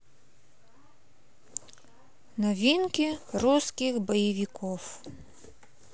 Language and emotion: Russian, neutral